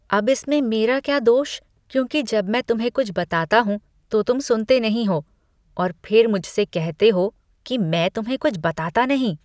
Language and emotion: Hindi, disgusted